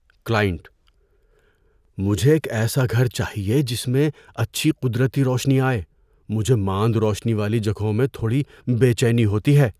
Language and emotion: Urdu, fearful